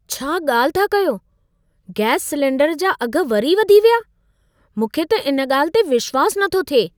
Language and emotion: Sindhi, surprised